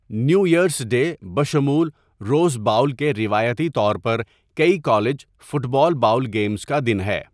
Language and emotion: Urdu, neutral